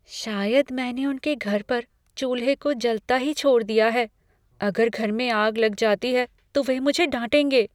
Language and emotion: Hindi, fearful